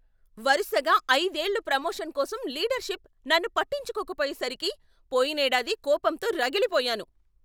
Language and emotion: Telugu, angry